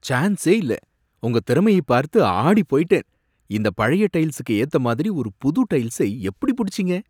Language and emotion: Tamil, surprised